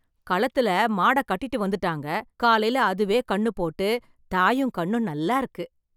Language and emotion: Tamil, surprised